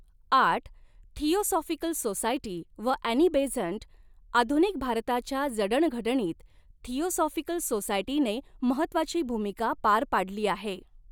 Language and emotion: Marathi, neutral